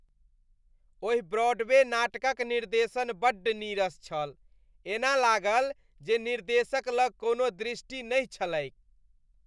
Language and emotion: Maithili, disgusted